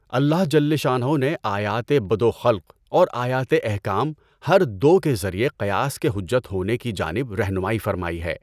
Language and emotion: Urdu, neutral